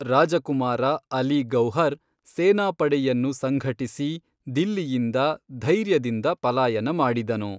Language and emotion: Kannada, neutral